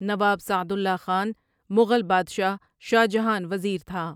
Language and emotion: Urdu, neutral